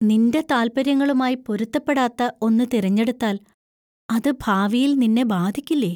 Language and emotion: Malayalam, fearful